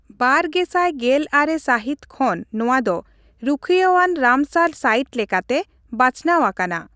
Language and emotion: Santali, neutral